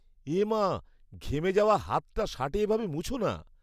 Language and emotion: Bengali, disgusted